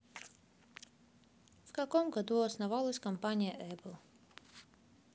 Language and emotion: Russian, neutral